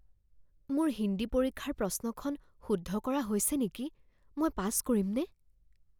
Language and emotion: Assamese, fearful